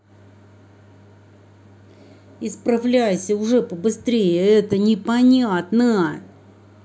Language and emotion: Russian, angry